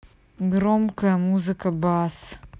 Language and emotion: Russian, neutral